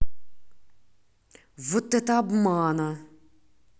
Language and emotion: Russian, angry